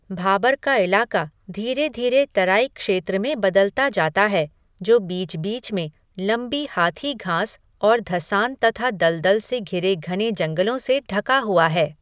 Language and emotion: Hindi, neutral